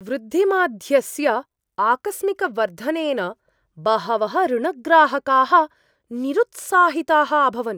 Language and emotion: Sanskrit, surprised